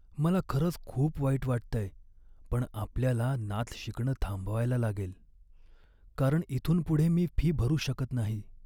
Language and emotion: Marathi, sad